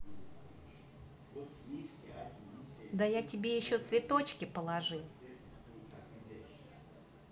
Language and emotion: Russian, neutral